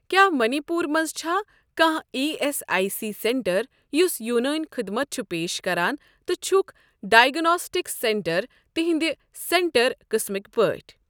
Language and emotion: Kashmiri, neutral